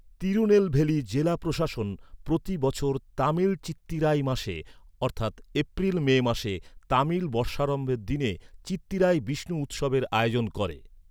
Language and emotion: Bengali, neutral